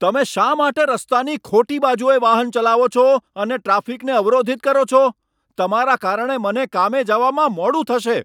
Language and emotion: Gujarati, angry